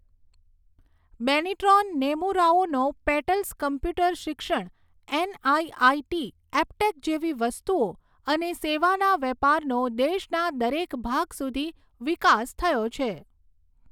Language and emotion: Gujarati, neutral